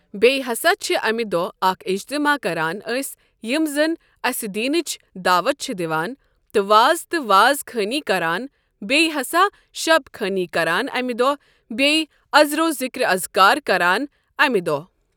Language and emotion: Kashmiri, neutral